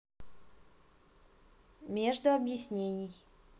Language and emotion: Russian, neutral